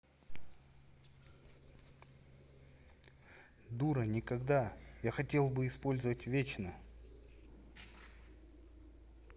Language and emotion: Russian, neutral